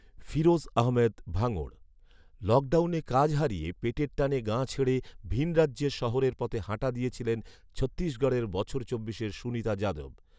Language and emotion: Bengali, neutral